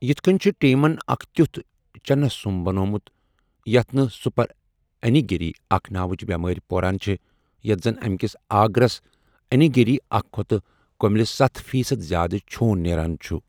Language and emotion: Kashmiri, neutral